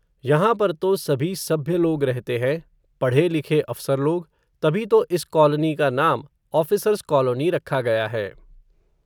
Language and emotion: Hindi, neutral